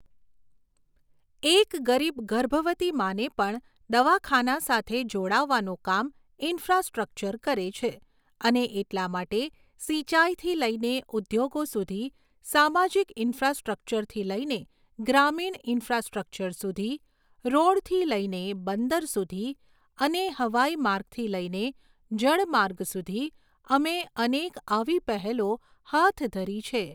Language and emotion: Gujarati, neutral